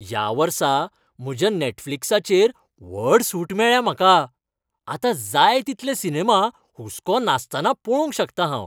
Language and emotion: Goan Konkani, happy